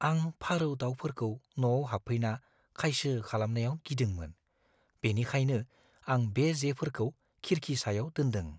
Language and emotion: Bodo, fearful